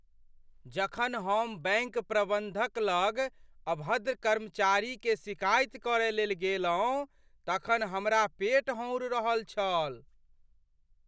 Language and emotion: Maithili, fearful